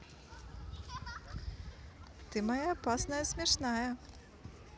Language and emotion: Russian, positive